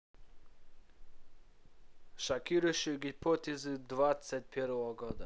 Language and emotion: Russian, neutral